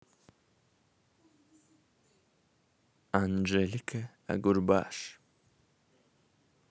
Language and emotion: Russian, positive